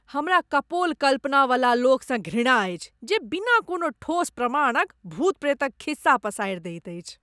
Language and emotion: Maithili, disgusted